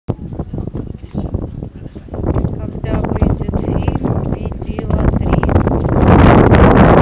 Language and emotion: Russian, neutral